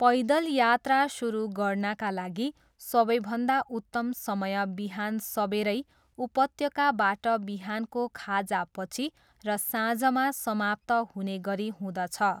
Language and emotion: Nepali, neutral